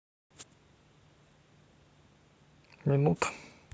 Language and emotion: Russian, neutral